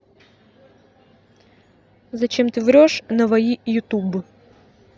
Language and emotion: Russian, neutral